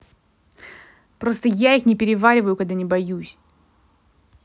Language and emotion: Russian, angry